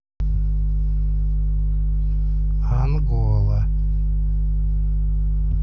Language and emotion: Russian, neutral